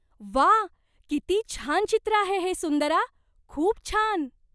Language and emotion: Marathi, surprised